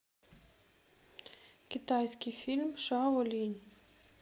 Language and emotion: Russian, neutral